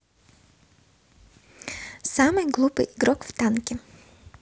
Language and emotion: Russian, neutral